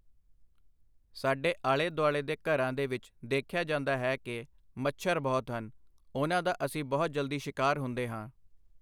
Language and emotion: Punjabi, neutral